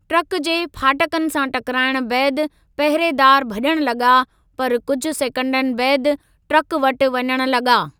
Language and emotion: Sindhi, neutral